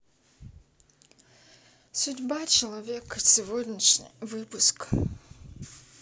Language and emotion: Russian, neutral